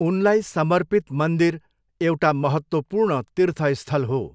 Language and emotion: Nepali, neutral